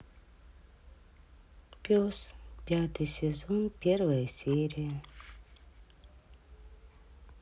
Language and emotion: Russian, sad